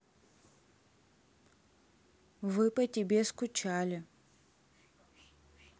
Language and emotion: Russian, neutral